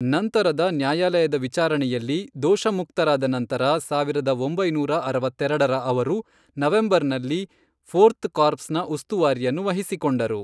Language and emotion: Kannada, neutral